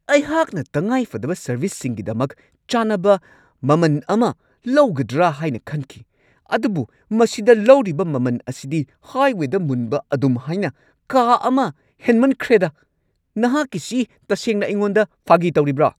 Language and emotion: Manipuri, angry